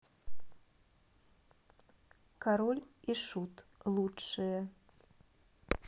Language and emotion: Russian, neutral